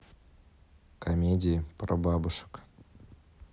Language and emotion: Russian, neutral